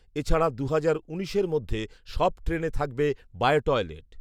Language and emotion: Bengali, neutral